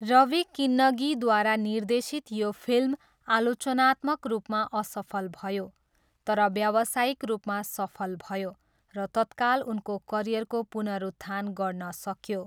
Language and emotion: Nepali, neutral